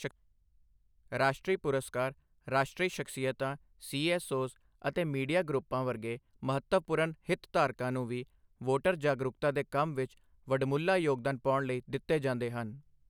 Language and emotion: Punjabi, neutral